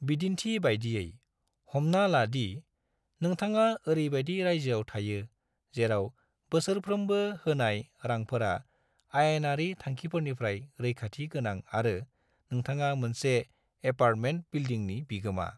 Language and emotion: Bodo, neutral